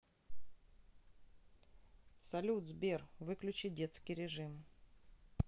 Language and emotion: Russian, neutral